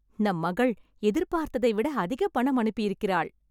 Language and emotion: Tamil, happy